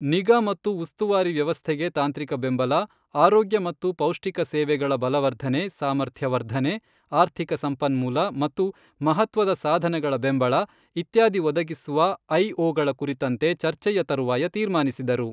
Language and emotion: Kannada, neutral